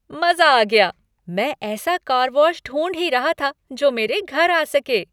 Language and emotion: Hindi, happy